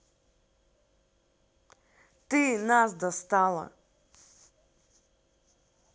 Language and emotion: Russian, angry